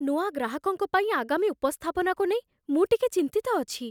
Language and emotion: Odia, fearful